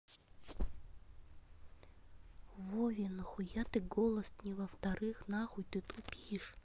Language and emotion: Russian, angry